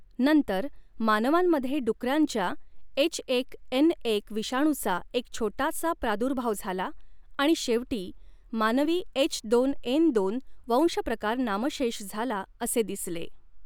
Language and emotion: Marathi, neutral